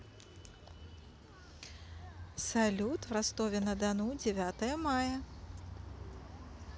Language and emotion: Russian, positive